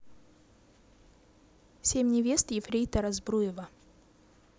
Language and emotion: Russian, neutral